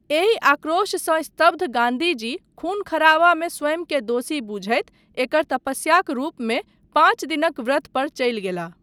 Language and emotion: Maithili, neutral